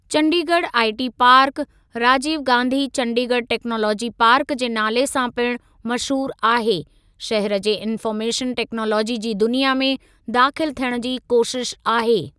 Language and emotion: Sindhi, neutral